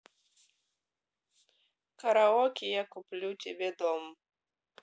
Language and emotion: Russian, neutral